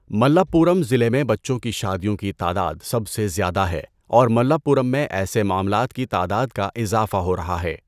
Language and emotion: Urdu, neutral